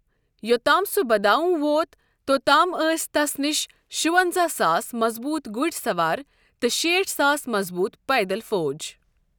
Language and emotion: Kashmiri, neutral